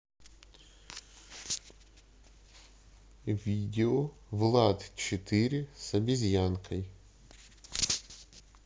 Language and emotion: Russian, neutral